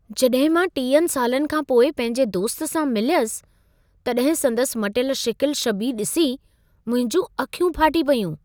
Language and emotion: Sindhi, surprised